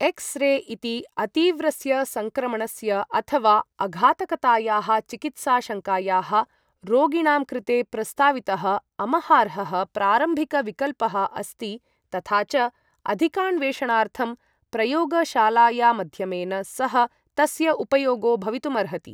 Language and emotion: Sanskrit, neutral